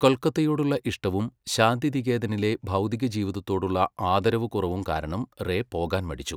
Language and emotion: Malayalam, neutral